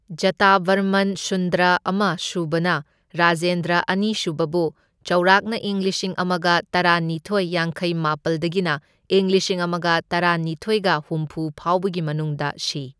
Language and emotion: Manipuri, neutral